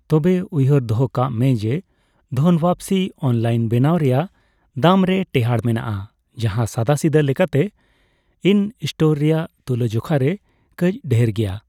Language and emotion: Santali, neutral